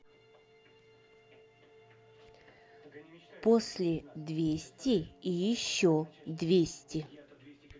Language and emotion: Russian, neutral